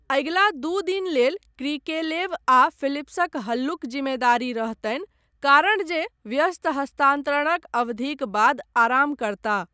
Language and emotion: Maithili, neutral